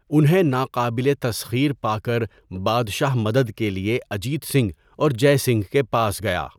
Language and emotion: Urdu, neutral